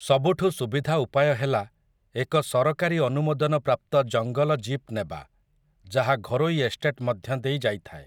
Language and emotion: Odia, neutral